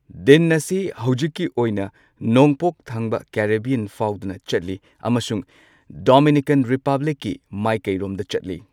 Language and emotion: Manipuri, neutral